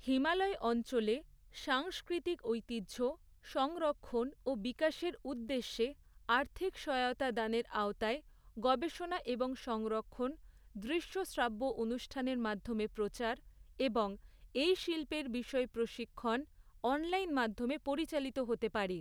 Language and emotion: Bengali, neutral